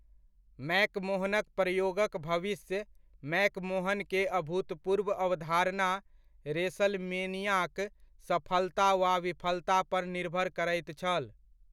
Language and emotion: Maithili, neutral